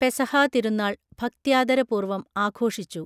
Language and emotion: Malayalam, neutral